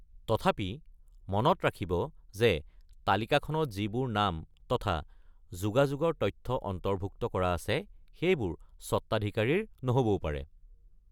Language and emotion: Assamese, neutral